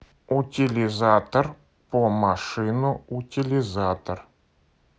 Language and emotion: Russian, neutral